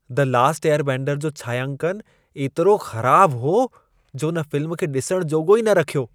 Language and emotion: Sindhi, disgusted